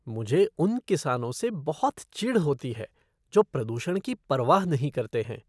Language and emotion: Hindi, disgusted